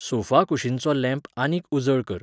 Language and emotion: Goan Konkani, neutral